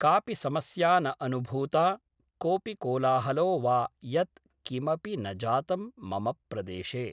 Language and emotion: Sanskrit, neutral